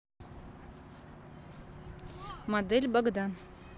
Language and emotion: Russian, neutral